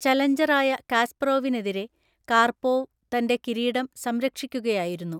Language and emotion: Malayalam, neutral